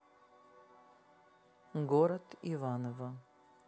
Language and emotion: Russian, neutral